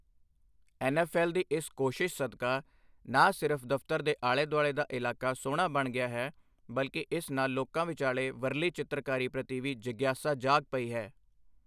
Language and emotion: Punjabi, neutral